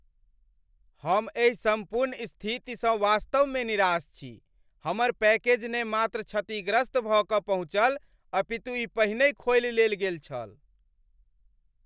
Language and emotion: Maithili, angry